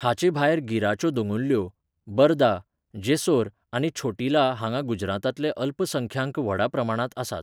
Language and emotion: Goan Konkani, neutral